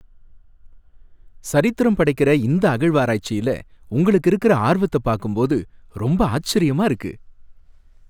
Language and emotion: Tamil, happy